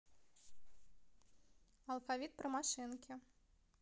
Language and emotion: Russian, neutral